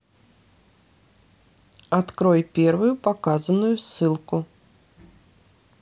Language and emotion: Russian, neutral